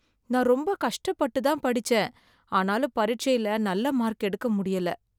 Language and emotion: Tamil, sad